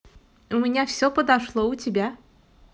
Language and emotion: Russian, positive